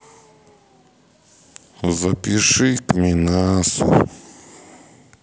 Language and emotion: Russian, sad